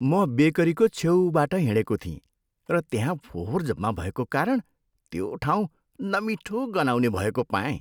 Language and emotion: Nepali, disgusted